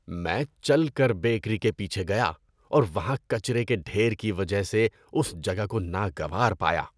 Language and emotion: Urdu, disgusted